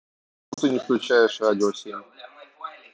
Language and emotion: Russian, neutral